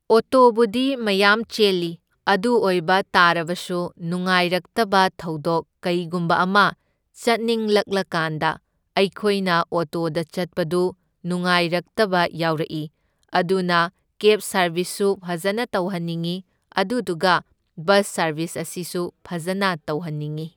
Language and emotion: Manipuri, neutral